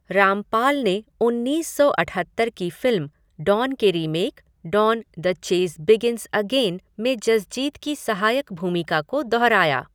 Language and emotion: Hindi, neutral